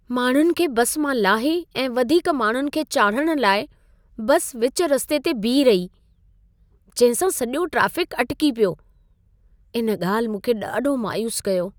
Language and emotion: Sindhi, sad